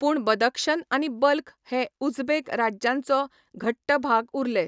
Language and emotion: Goan Konkani, neutral